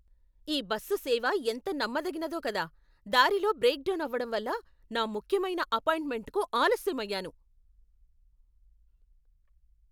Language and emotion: Telugu, angry